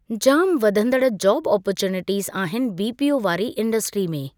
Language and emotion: Sindhi, neutral